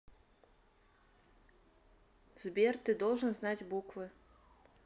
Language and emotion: Russian, neutral